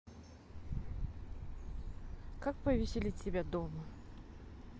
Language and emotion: Russian, neutral